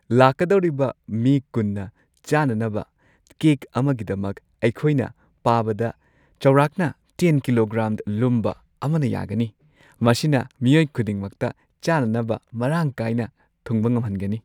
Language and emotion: Manipuri, happy